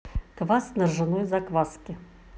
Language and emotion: Russian, neutral